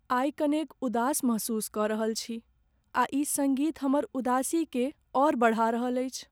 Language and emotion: Maithili, sad